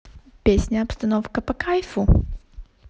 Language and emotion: Russian, positive